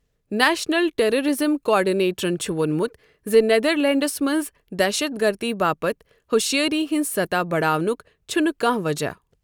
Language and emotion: Kashmiri, neutral